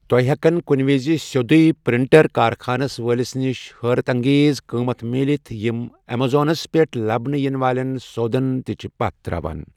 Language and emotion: Kashmiri, neutral